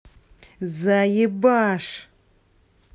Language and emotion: Russian, angry